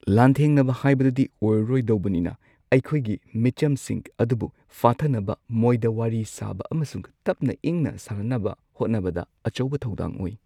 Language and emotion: Manipuri, neutral